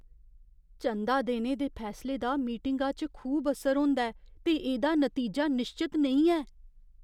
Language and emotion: Dogri, fearful